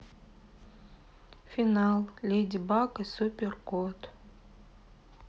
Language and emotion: Russian, sad